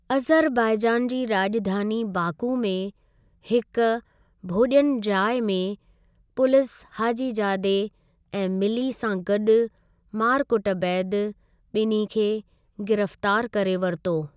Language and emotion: Sindhi, neutral